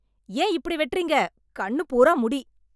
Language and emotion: Tamil, angry